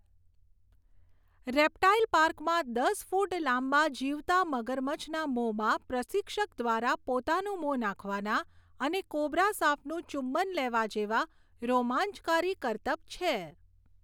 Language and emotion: Gujarati, neutral